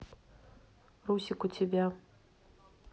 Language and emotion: Russian, neutral